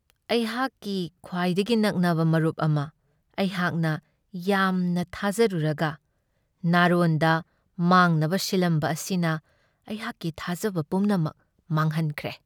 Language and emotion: Manipuri, sad